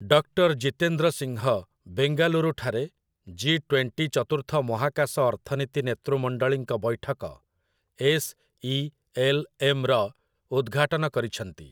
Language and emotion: Odia, neutral